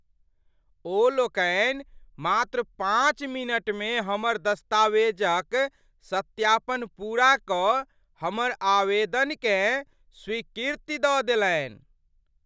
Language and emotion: Maithili, surprised